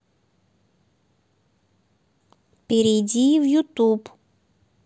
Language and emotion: Russian, neutral